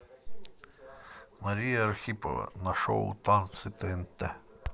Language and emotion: Russian, neutral